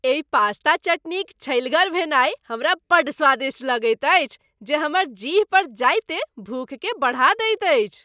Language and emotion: Maithili, happy